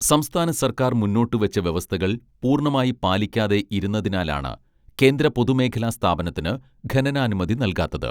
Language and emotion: Malayalam, neutral